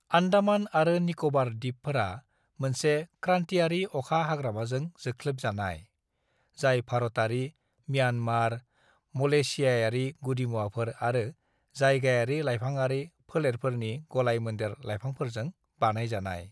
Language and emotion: Bodo, neutral